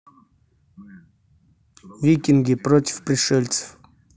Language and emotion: Russian, neutral